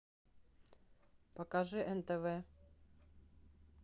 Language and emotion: Russian, neutral